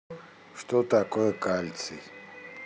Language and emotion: Russian, neutral